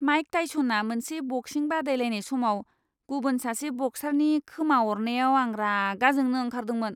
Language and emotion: Bodo, disgusted